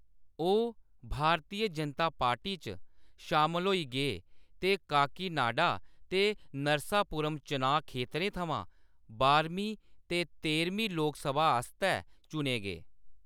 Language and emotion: Dogri, neutral